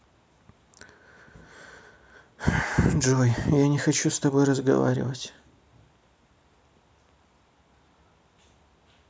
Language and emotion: Russian, sad